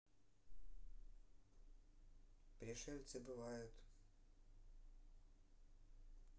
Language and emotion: Russian, neutral